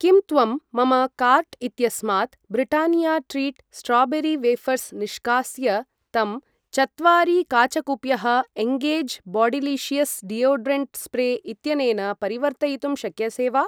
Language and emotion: Sanskrit, neutral